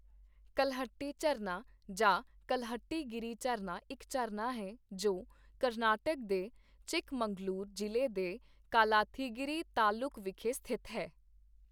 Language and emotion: Punjabi, neutral